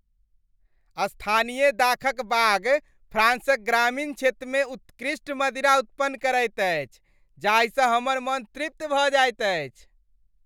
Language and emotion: Maithili, happy